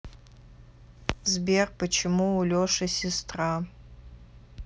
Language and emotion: Russian, neutral